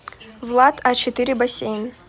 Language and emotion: Russian, neutral